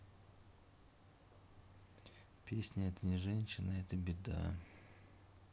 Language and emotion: Russian, sad